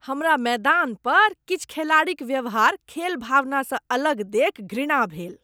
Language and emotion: Maithili, disgusted